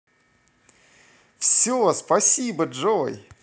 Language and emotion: Russian, positive